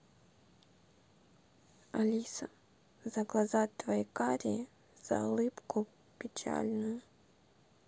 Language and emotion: Russian, neutral